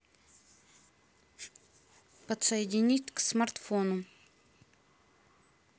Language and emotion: Russian, neutral